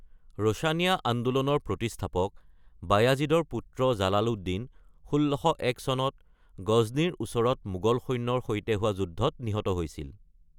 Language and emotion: Assamese, neutral